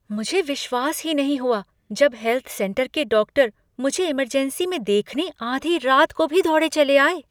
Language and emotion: Hindi, surprised